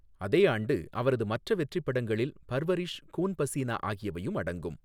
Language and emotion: Tamil, neutral